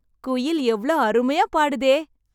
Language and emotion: Tamil, happy